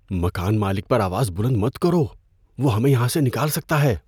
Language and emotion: Urdu, fearful